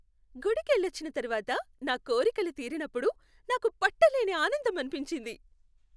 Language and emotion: Telugu, happy